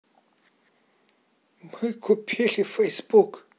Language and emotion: Russian, neutral